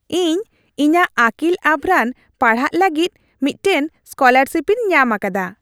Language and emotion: Santali, happy